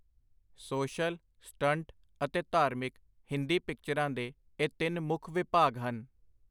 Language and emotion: Punjabi, neutral